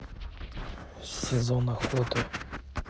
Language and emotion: Russian, neutral